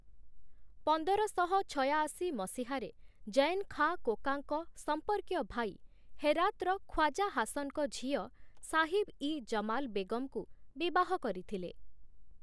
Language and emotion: Odia, neutral